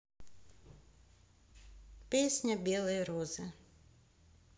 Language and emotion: Russian, neutral